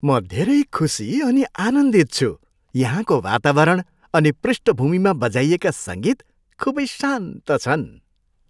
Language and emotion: Nepali, happy